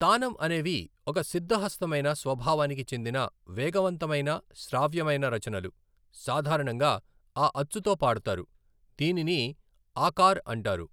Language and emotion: Telugu, neutral